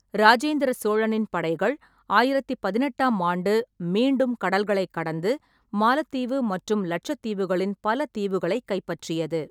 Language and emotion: Tamil, neutral